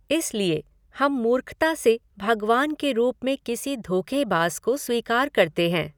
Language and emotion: Hindi, neutral